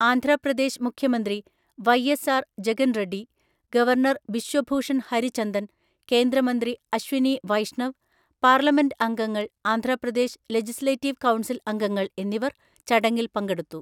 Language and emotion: Malayalam, neutral